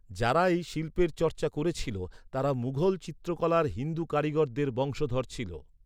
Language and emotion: Bengali, neutral